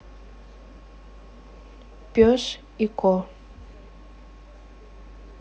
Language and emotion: Russian, neutral